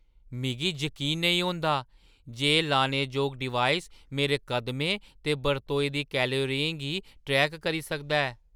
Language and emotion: Dogri, surprised